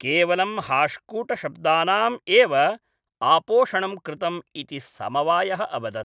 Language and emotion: Sanskrit, neutral